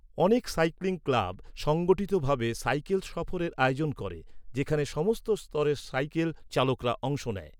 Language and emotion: Bengali, neutral